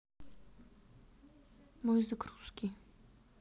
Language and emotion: Russian, sad